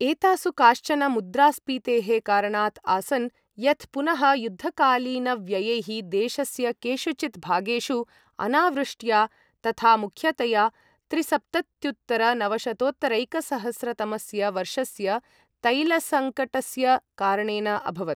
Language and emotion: Sanskrit, neutral